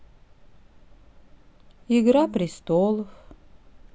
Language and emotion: Russian, sad